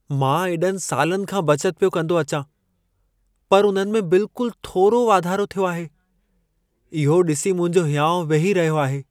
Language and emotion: Sindhi, sad